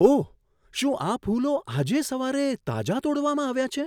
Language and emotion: Gujarati, surprised